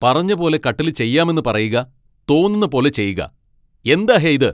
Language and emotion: Malayalam, angry